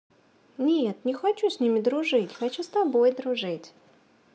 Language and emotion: Russian, positive